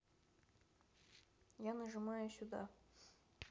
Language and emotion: Russian, neutral